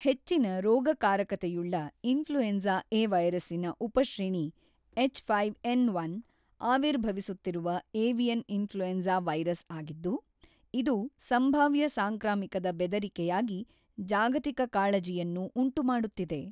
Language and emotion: Kannada, neutral